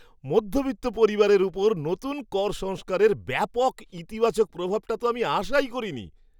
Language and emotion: Bengali, surprised